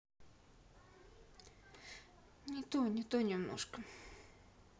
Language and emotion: Russian, sad